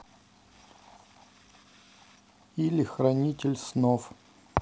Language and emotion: Russian, neutral